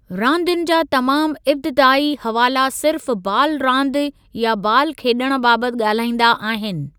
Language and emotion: Sindhi, neutral